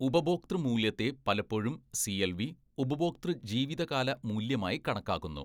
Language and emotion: Malayalam, neutral